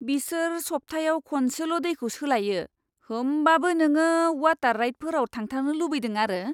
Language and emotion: Bodo, disgusted